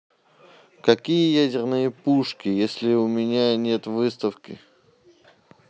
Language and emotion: Russian, neutral